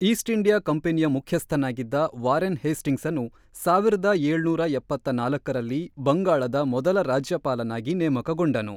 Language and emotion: Kannada, neutral